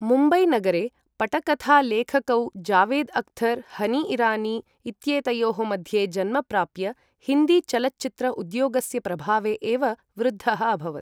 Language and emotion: Sanskrit, neutral